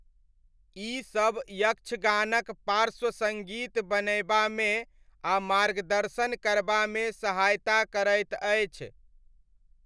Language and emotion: Maithili, neutral